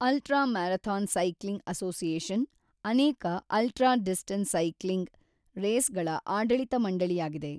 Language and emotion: Kannada, neutral